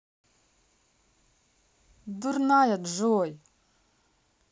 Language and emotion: Russian, neutral